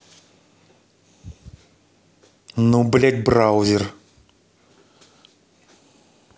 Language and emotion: Russian, angry